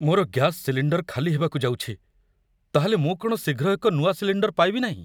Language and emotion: Odia, fearful